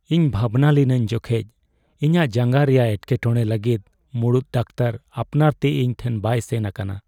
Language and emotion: Santali, sad